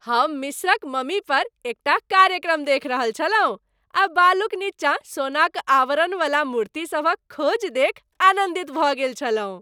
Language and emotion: Maithili, happy